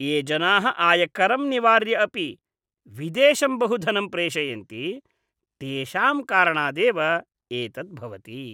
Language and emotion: Sanskrit, disgusted